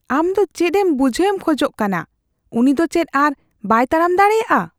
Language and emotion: Santali, fearful